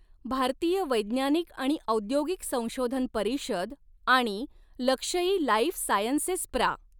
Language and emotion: Marathi, neutral